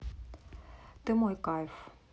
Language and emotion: Russian, neutral